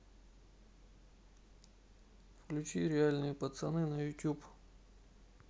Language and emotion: Russian, neutral